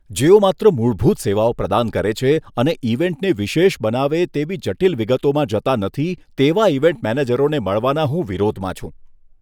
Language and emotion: Gujarati, disgusted